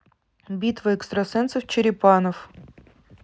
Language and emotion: Russian, neutral